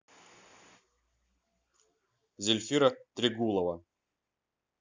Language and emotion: Russian, neutral